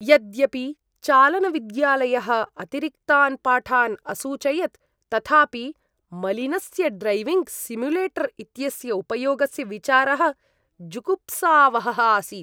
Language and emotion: Sanskrit, disgusted